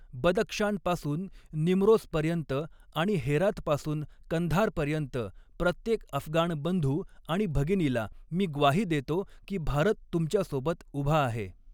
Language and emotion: Marathi, neutral